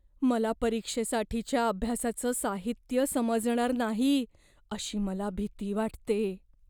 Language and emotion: Marathi, fearful